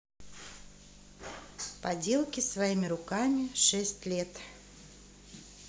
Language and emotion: Russian, neutral